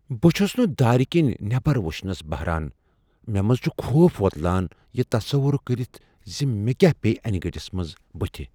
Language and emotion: Kashmiri, fearful